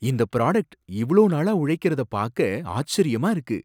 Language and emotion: Tamil, surprised